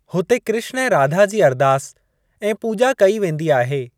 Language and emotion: Sindhi, neutral